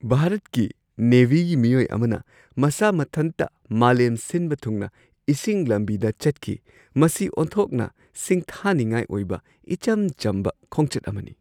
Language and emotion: Manipuri, surprised